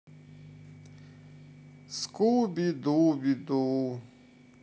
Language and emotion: Russian, sad